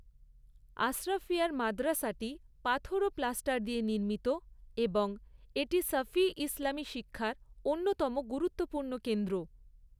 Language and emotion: Bengali, neutral